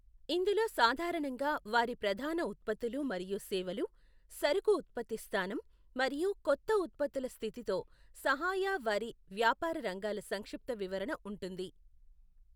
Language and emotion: Telugu, neutral